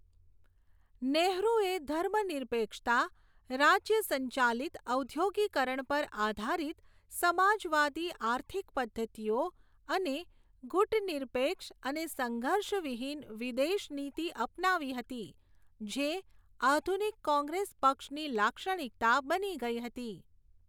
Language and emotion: Gujarati, neutral